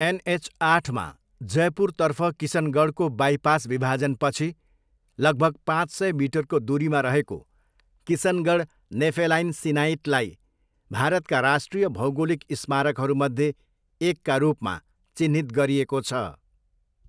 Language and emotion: Nepali, neutral